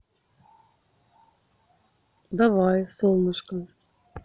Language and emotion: Russian, neutral